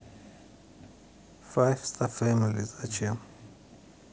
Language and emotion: Russian, neutral